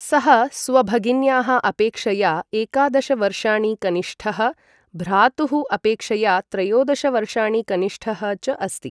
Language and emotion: Sanskrit, neutral